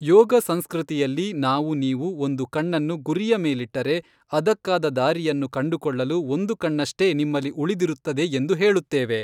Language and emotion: Kannada, neutral